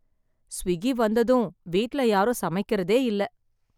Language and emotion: Tamil, sad